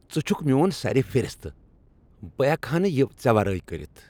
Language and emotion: Kashmiri, happy